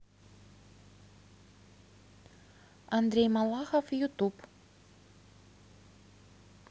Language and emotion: Russian, neutral